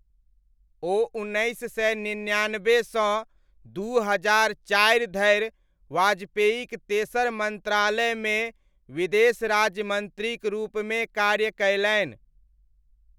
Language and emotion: Maithili, neutral